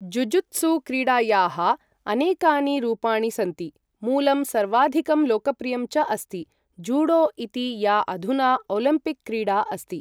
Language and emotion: Sanskrit, neutral